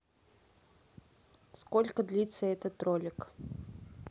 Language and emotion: Russian, neutral